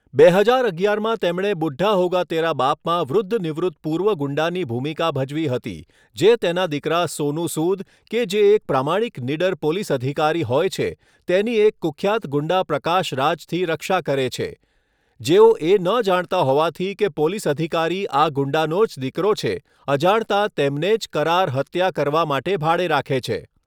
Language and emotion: Gujarati, neutral